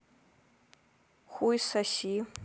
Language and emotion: Russian, neutral